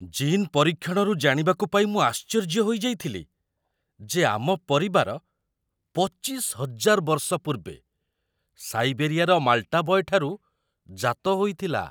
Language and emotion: Odia, surprised